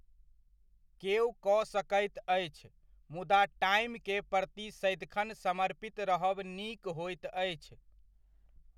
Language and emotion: Maithili, neutral